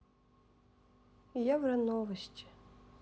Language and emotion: Russian, sad